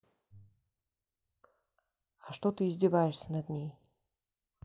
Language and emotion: Russian, angry